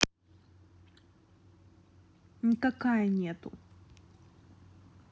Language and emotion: Russian, neutral